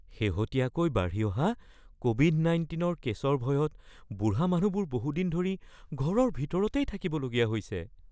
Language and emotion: Assamese, fearful